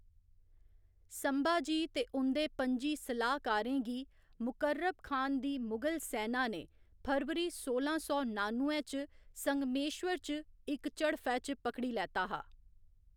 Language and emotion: Dogri, neutral